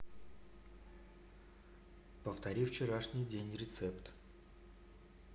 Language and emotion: Russian, neutral